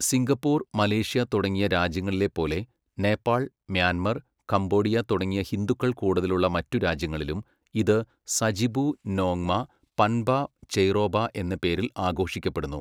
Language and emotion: Malayalam, neutral